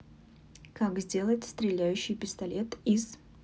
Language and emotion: Russian, neutral